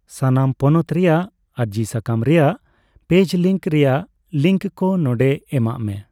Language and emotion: Santali, neutral